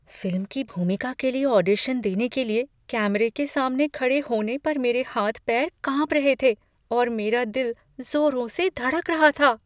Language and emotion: Hindi, fearful